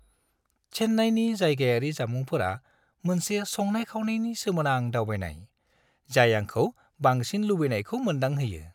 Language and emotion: Bodo, happy